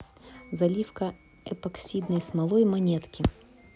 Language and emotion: Russian, neutral